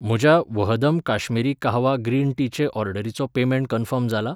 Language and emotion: Goan Konkani, neutral